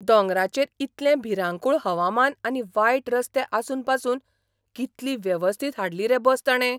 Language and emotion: Goan Konkani, surprised